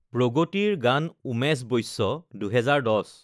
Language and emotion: Assamese, neutral